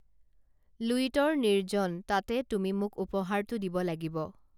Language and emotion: Assamese, neutral